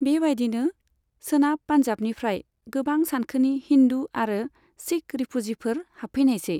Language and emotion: Bodo, neutral